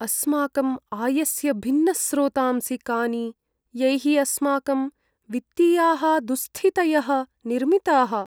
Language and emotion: Sanskrit, sad